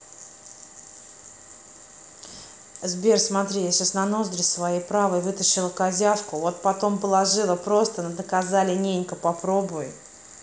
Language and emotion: Russian, neutral